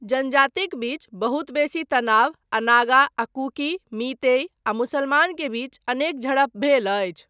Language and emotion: Maithili, neutral